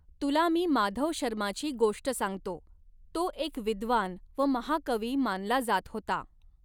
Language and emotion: Marathi, neutral